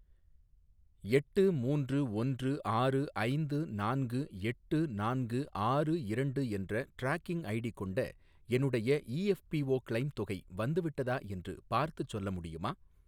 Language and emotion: Tamil, neutral